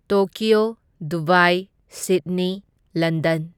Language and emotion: Manipuri, neutral